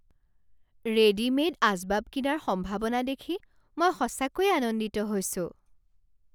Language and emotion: Assamese, surprised